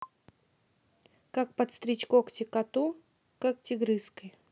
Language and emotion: Russian, neutral